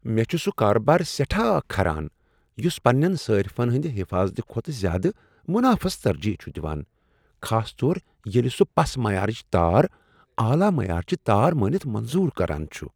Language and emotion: Kashmiri, disgusted